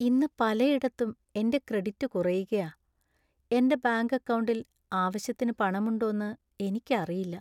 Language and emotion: Malayalam, sad